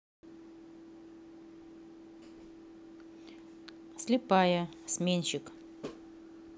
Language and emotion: Russian, neutral